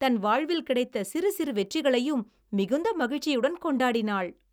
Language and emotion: Tamil, happy